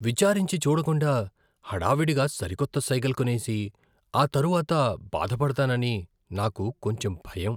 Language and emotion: Telugu, fearful